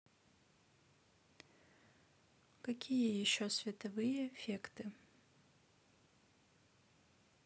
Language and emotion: Russian, neutral